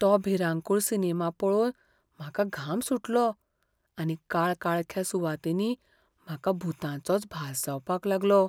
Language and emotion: Goan Konkani, fearful